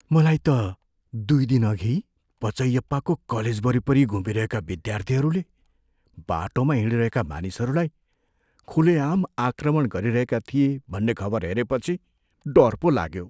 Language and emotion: Nepali, fearful